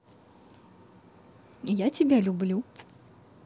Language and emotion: Russian, positive